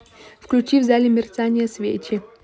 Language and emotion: Russian, neutral